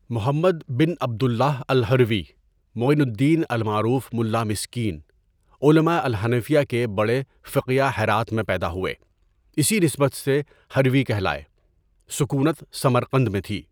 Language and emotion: Urdu, neutral